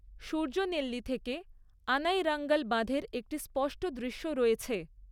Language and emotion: Bengali, neutral